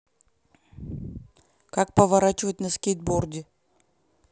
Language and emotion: Russian, neutral